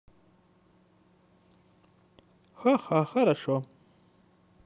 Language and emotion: Russian, positive